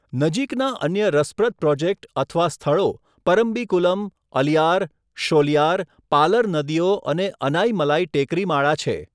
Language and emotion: Gujarati, neutral